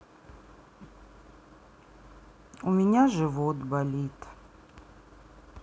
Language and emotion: Russian, sad